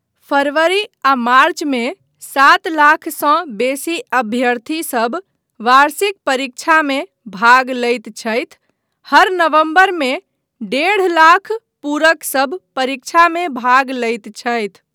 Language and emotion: Maithili, neutral